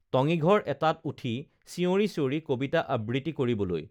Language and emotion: Assamese, neutral